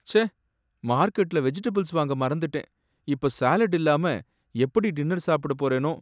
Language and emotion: Tamil, sad